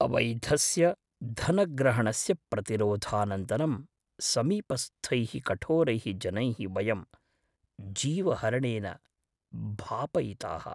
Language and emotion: Sanskrit, fearful